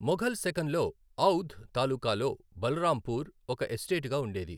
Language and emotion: Telugu, neutral